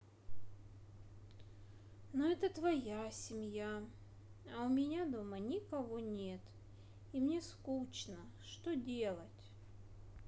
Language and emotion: Russian, sad